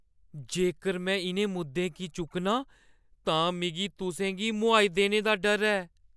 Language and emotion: Dogri, fearful